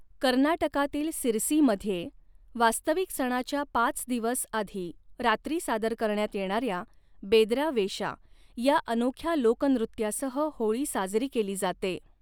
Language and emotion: Marathi, neutral